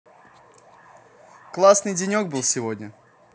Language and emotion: Russian, positive